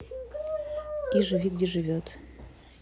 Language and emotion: Russian, neutral